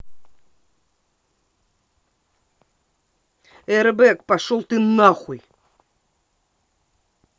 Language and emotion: Russian, angry